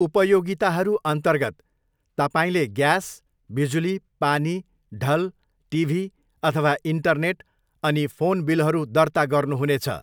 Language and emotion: Nepali, neutral